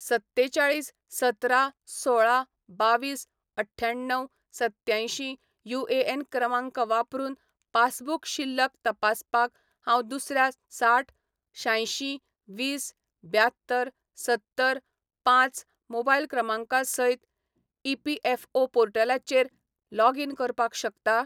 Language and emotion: Goan Konkani, neutral